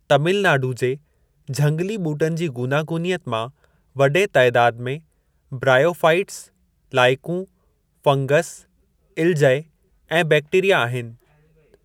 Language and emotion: Sindhi, neutral